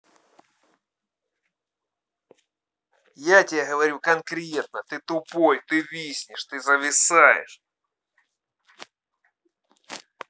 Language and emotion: Russian, angry